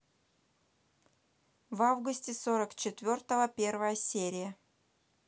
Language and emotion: Russian, neutral